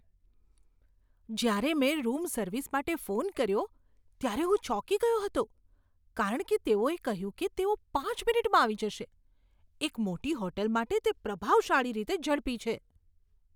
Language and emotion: Gujarati, surprised